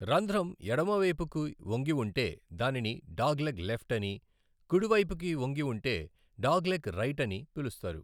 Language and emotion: Telugu, neutral